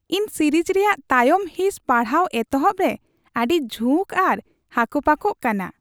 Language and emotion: Santali, happy